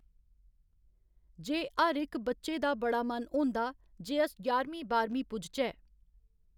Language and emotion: Dogri, neutral